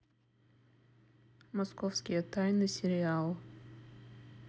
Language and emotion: Russian, neutral